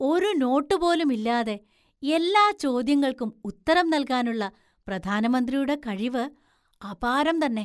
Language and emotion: Malayalam, surprised